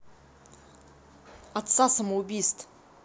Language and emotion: Russian, angry